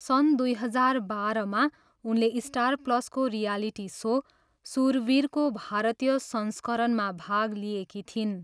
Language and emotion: Nepali, neutral